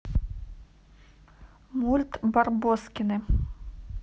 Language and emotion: Russian, neutral